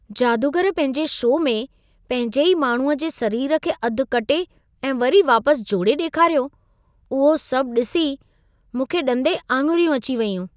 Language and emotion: Sindhi, surprised